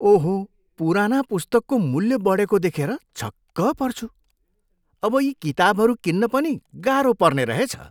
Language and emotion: Nepali, surprised